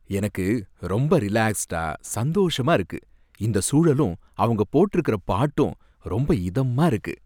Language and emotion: Tamil, happy